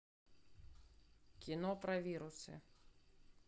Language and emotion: Russian, neutral